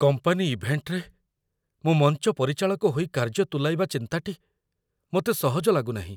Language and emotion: Odia, fearful